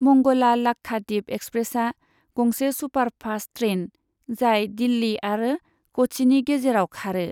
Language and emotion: Bodo, neutral